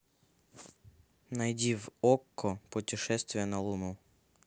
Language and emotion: Russian, neutral